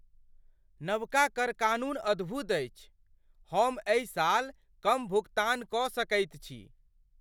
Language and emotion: Maithili, surprised